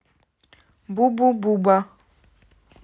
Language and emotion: Russian, neutral